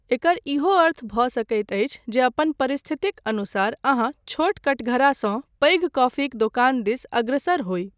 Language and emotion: Maithili, neutral